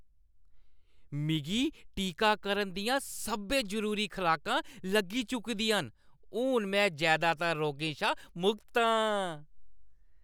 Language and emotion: Dogri, happy